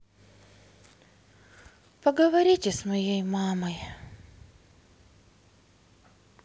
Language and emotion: Russian, sad